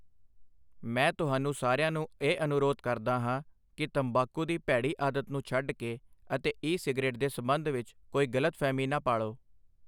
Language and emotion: Punjabi, neutral